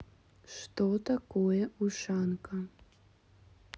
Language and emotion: Russian, neutral